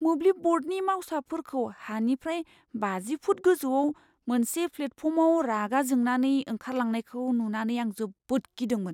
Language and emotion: Bodo, fearful